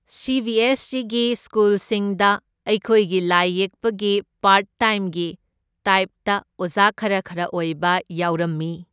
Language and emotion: Manipuri, neutral